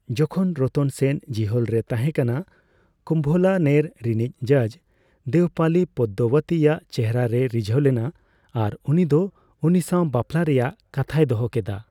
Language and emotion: Santali, neutral